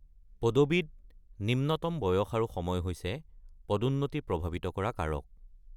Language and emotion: Assamese, neutral